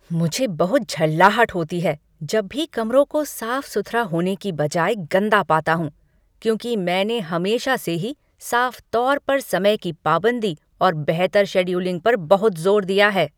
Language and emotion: Hindi, angry